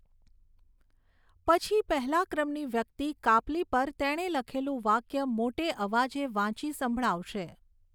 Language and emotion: Gujarati, neutral